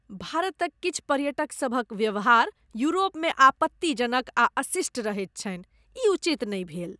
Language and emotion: Maithili, disgusted